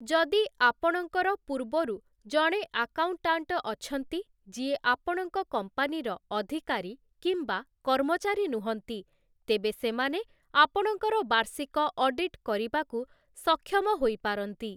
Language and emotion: Odia, neutral